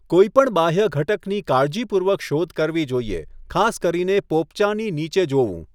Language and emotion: Gujarati, neutral